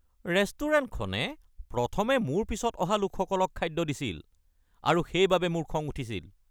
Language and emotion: Assamese, angry